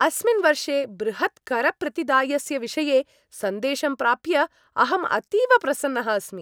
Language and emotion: Sanskrit, happy